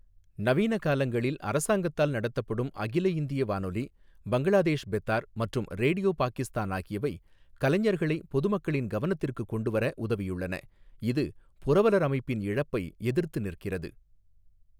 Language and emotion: Tamil, neutral